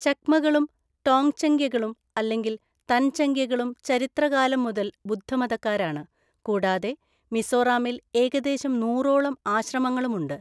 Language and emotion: Malayalam, neutral